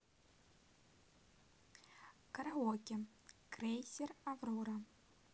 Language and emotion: Russian, positive